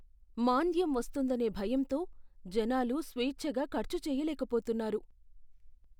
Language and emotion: Telugu, fearful